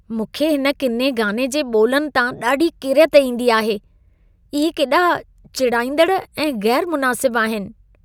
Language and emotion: Sindhi, disgusted